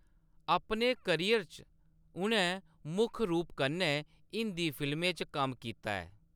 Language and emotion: Dogri, neutral